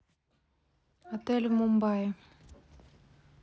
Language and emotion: Russian, neutral